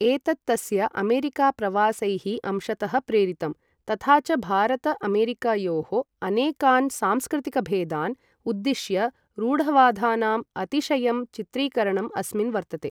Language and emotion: Sanskrit, neutral